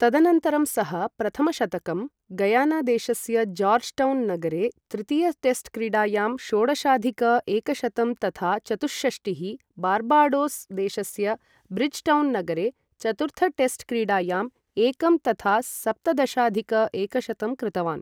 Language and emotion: Sanskrit, neutral